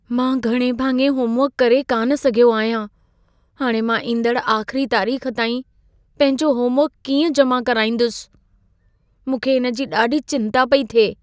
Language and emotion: Sindhi, fearful